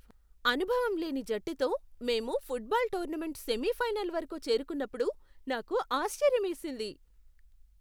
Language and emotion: Telugu, surprised